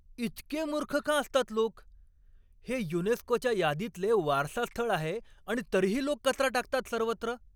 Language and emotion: Marathi, angry